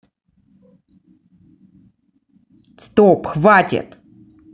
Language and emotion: Russian, angry